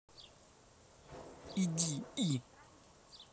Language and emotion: Russian, angry